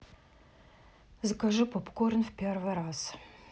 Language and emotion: Russian, neutral